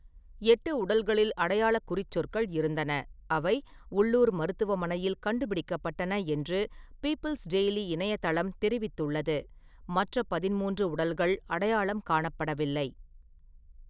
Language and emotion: Tamil, neutral